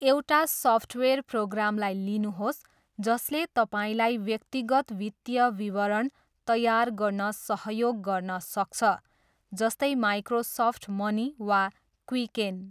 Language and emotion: Nepali, neutral